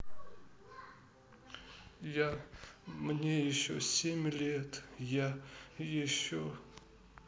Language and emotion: Russian, sad